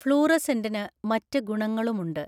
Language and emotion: Malayalam, neutral